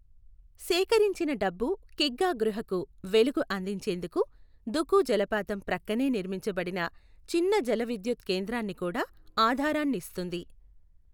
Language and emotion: Telugu, neutral